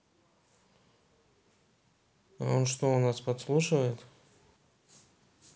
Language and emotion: Russian, neutral